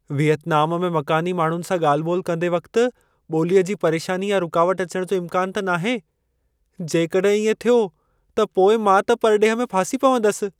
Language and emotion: Sindhi, fearful